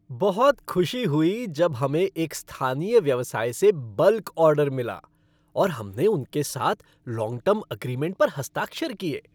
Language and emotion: Hindi, happy